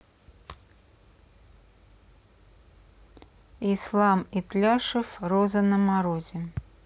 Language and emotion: Russian, neutral